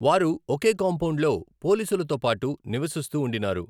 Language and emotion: Telugu, neutral